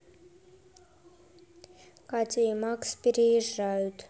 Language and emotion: Russian, neutral